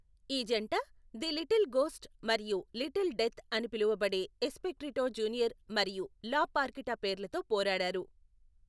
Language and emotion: Telugu, neutral